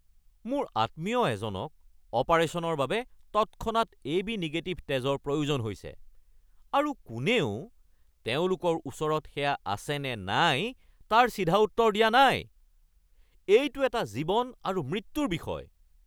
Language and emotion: Assamese, angry